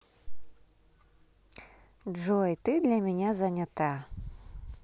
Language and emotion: Russian, positive